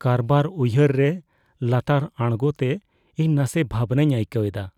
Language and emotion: Santali, fearful